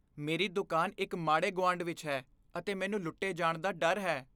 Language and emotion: Punjabi, fearful